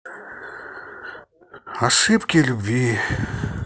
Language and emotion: Russian, sad